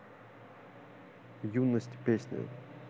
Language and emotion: Russian, neutral